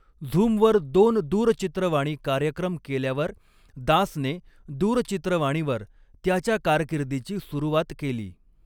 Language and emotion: Marathi, neutral